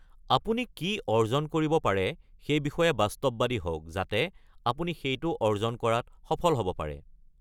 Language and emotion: Assamese, neutral